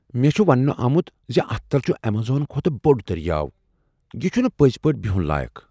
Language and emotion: Kashmiri, surprised